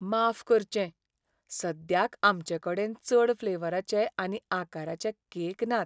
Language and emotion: Goan Konkani, sad